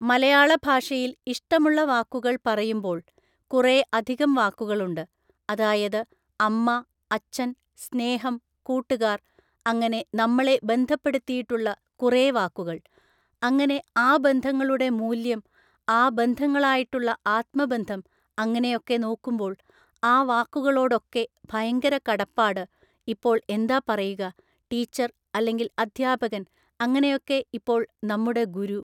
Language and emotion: Malayalam, neutral